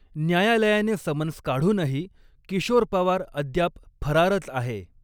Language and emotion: Marathi, neutral